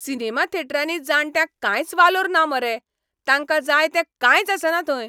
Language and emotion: Goan Konkani, angry